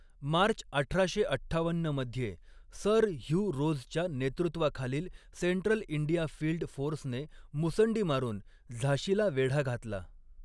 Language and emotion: Marathi, neutral